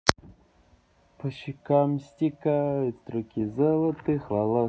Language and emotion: Russian, positive